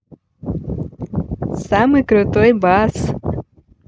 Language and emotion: Russian, positive